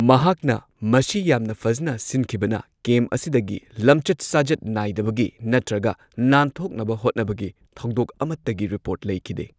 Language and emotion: Manipuri, neutral